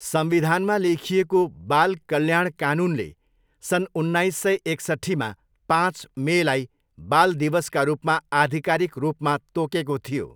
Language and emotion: Nepali, neutral